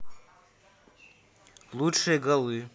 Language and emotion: Russian, neutral